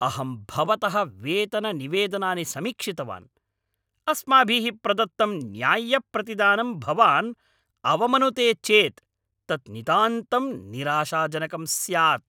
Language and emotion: Sanskrit, angry